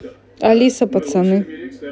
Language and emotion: Russian, neutral